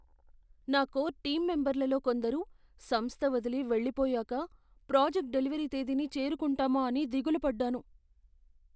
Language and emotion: Telugu, fearful